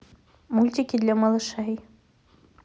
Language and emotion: Russian, neutral